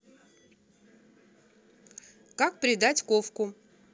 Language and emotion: Russian, neutral